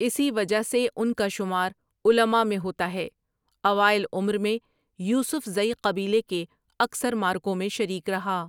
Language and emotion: Urdu, neutral